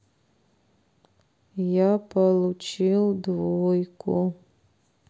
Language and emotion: Russian, sad